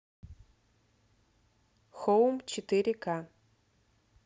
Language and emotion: Russian, neutral